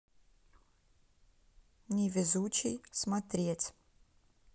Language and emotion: Russian, neutral